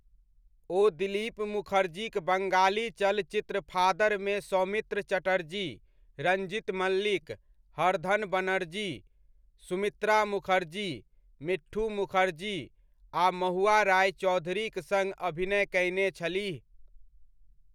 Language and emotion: Maithili, neutral